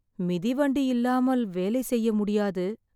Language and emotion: Tamil, sad